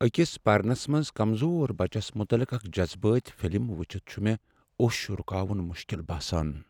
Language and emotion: Kashmiri, sad